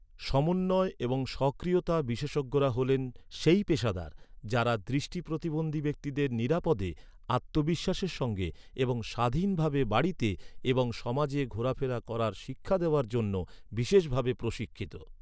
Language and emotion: Bengali, neutral